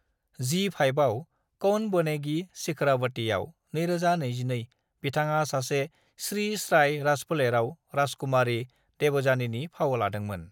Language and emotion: Bodo, neutral